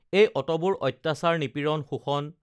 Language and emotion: Assamese, neutral